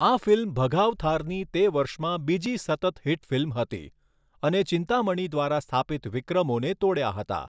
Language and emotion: Gujarati, neutral